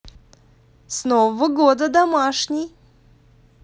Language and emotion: Russian, positive